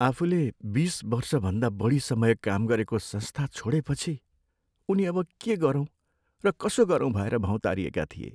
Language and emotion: Nepali, sad